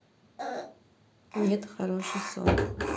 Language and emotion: Russian, neutral